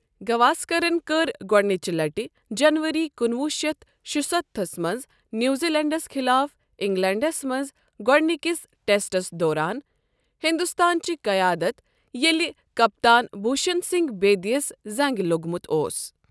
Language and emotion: Kashmiri, neutral